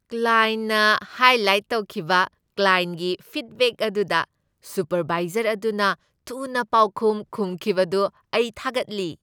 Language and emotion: Manipuri, happy